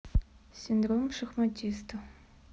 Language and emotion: Russian, neutral